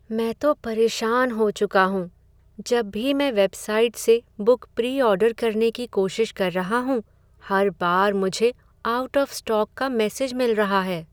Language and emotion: Hindi, sad